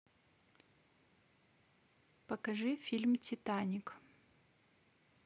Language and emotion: Russian, neutral